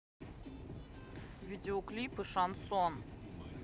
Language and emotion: Russian, neutral